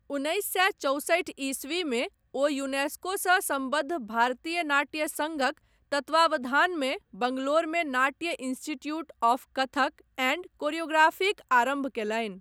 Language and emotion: Maithili, neutral